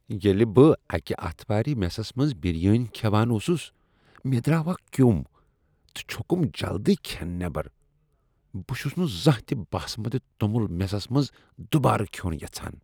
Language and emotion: Kashmiri, disgusted